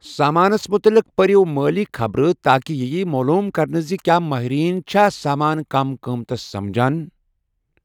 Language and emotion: Kashmiri, neutral